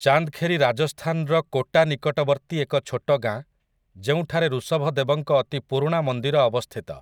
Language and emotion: Odia, neutral